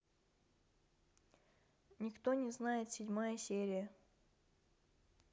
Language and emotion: Russian, neutral